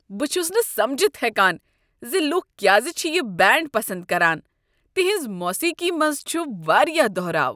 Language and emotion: Kashmiri, disgusted